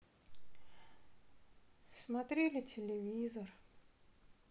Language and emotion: Russian, sad